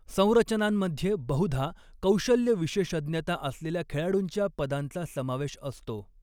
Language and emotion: Marathi, neutral